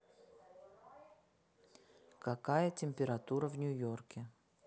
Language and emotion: Russian, neutral